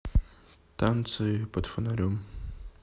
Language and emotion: Russian, neutral